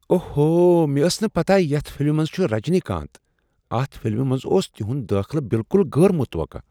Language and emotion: Kashmiri, surprised